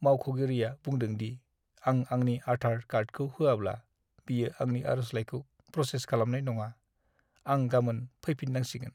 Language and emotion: Bodo, sad